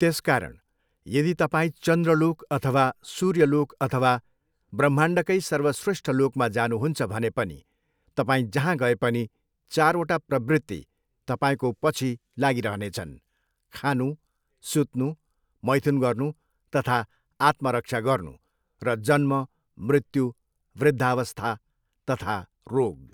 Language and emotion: Nepali, neutral